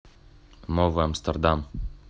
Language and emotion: Russian, neutral